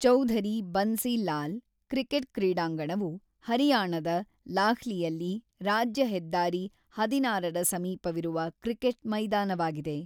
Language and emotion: Kannada, neutral